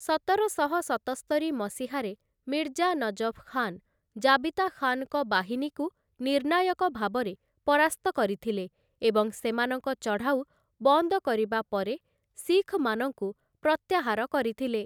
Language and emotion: Odia, neutral